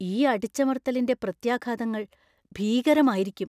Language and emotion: Malayalam, fearful